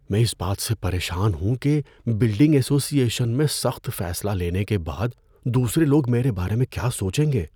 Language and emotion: Urdu, fearful